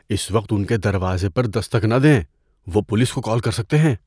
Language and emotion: Urdu, fearful